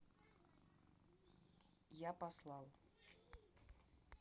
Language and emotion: Russian, neutral